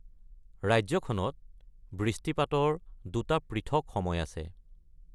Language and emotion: Assamese, neutral